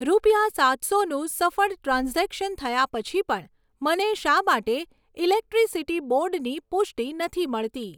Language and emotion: Gujarati, neutral